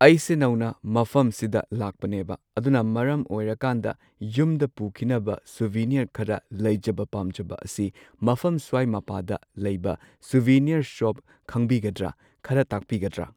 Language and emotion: Manipuri, neutral